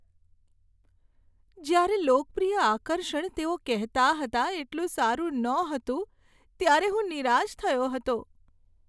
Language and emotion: Gujarati, sad